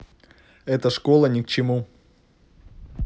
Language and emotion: Russian, angry